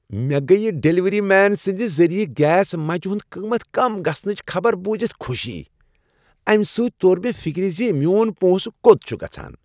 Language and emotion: Kashmiri, happy